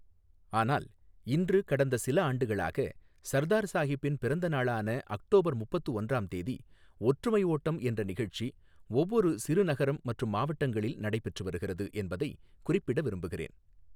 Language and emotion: Tamil, neutral